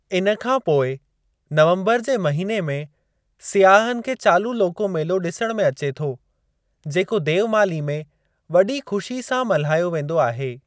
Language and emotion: Sindhi, neutral